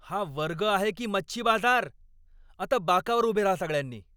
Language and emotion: Marathi, angry